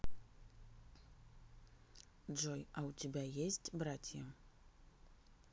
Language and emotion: Russian, neutral